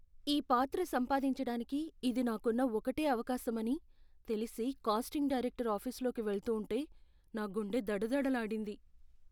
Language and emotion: Telugu, fearful